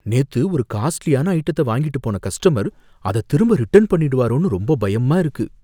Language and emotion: Tamil, fearful